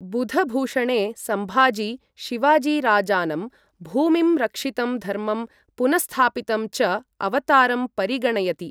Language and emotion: Sanskrit, neutral